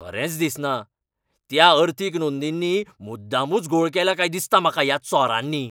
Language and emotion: Goan Konkani, angry